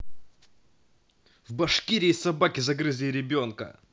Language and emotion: Russian, angry